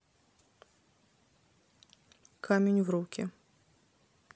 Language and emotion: Russian, neutral